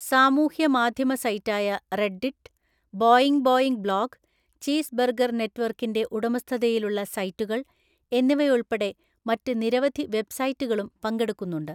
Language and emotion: Malayalam, neutral